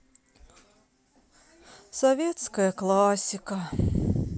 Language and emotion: Russian, sad